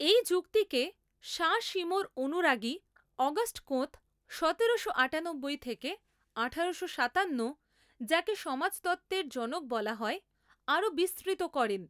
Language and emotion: Bengali, neutral